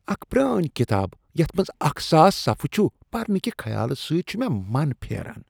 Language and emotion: Kashmiri, disgusted